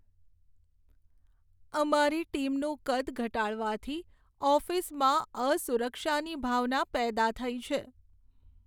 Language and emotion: Gujarati, sad